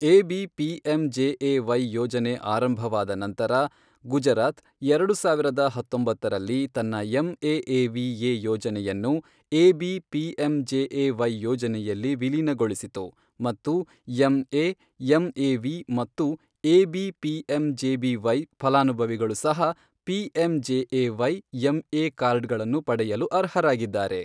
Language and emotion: Kannada, neutral